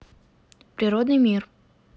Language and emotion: Russian, neutral